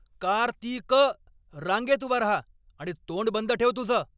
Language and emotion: Marathi, angry